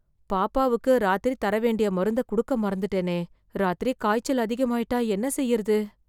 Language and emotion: Tamil, fearful